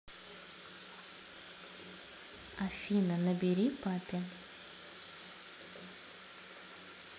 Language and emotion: Russian, neutral